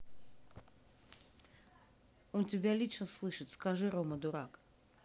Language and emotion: Russian, neutral